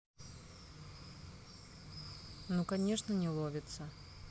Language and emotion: Russian, sad